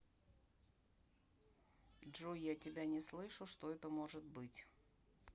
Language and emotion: Russian, neutral